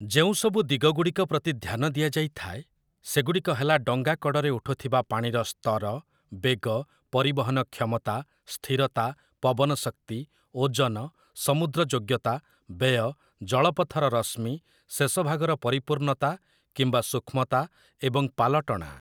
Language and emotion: Odia, neutral